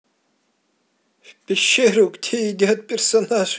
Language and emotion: Russian, positive